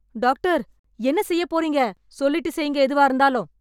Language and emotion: Tamil, angry